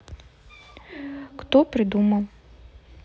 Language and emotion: Russian, neutral